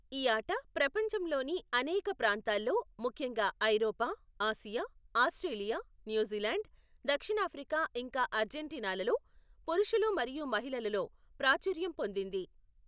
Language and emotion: Telugu, neutral